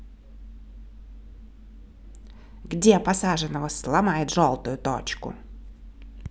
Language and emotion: Russian, angry